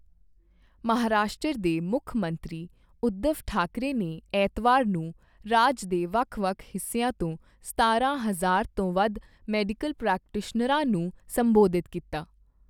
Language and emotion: Punjabi, neutral